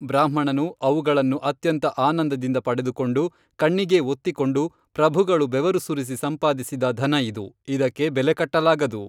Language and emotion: Kannada, neutral